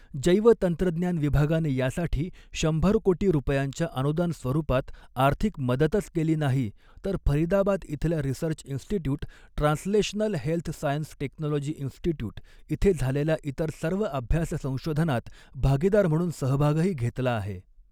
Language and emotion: Marathi, neutral